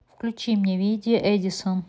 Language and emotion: Russian, neutral